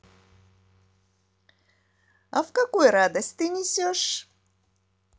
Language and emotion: Russian, positive